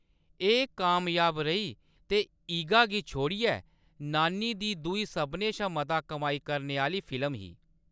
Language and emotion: Dogri, neutral